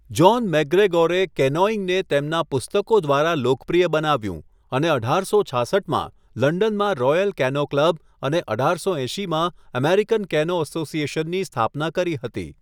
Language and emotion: Gujarati, neutral